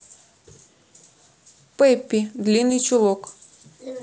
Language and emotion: Russian, neutral